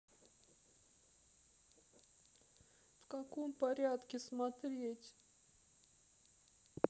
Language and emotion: Russian, sad